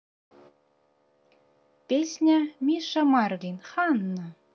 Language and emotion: Russian, neutral